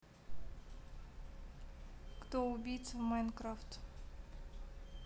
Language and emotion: Russian, neutral